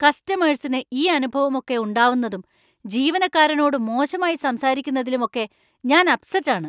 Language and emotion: Malayalam, angry